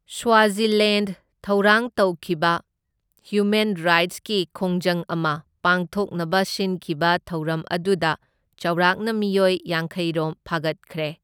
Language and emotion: Manipuri, neutral